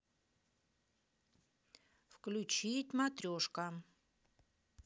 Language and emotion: Russian, neutral